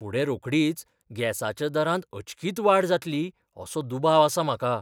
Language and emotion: Goan Konkani, fearful